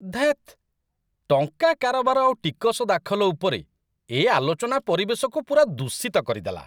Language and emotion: Odia, disgusted